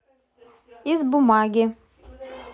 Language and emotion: Russian, neutral